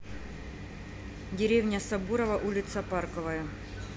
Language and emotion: Russian, neutral